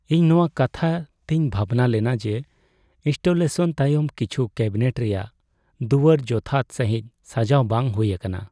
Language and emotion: Santali, sad